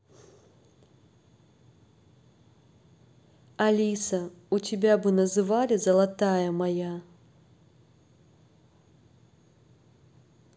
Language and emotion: Russian, neutral